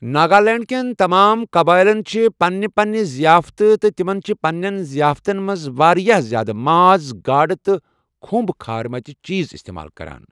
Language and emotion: Kashmiri, neutral